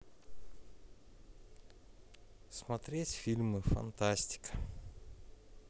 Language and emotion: Russian, neutral